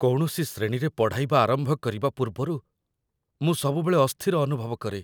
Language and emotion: Odia, fearful